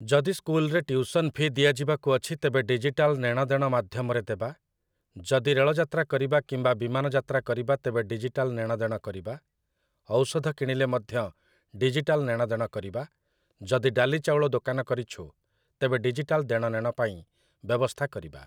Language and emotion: Odia, neutral